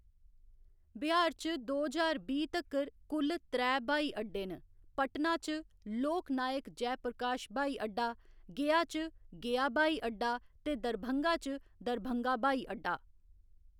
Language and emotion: Dogri, neutral